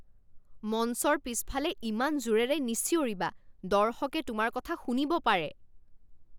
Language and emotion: Assamese, angry